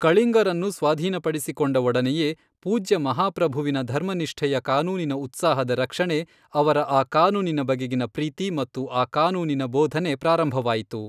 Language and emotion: Kannada, neutral